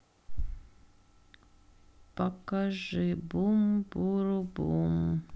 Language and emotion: Russian, sad